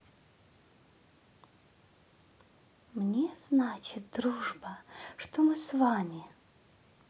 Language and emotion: Russian, positive